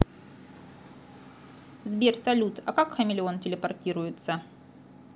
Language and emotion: Russian, neutral